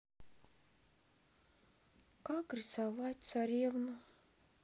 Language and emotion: Russian, sad